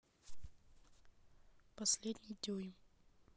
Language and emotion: Russian, neutral